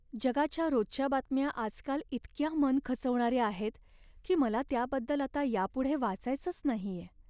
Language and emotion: Marathi, sad